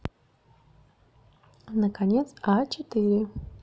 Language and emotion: Russian, neutral